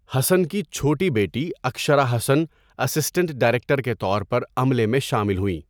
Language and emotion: Urdu, neutral